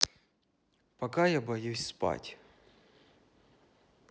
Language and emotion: Russian, neutral